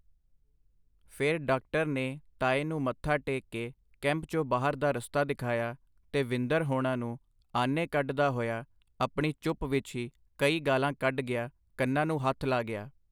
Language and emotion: Punjabi, neutral